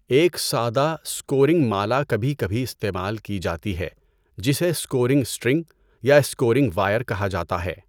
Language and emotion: Urdu, neutral